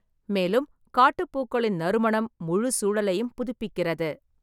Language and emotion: Tamil, neutral